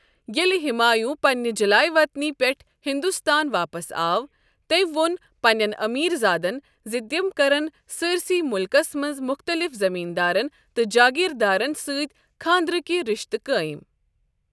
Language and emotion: Kashmiri, neutral